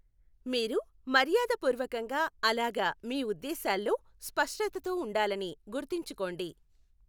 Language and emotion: Telugu, neutral